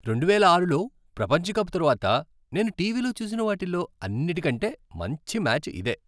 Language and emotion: Telugu, happy